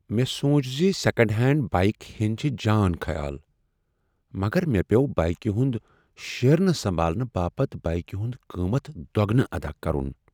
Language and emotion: Kashmiri, sad